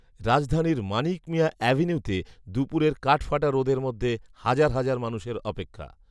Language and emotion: Bengali, neutral